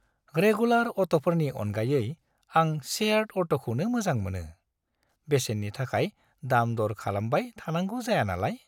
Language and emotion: Bodo, happy